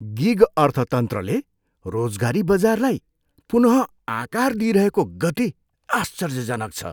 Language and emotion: Nepali, surprised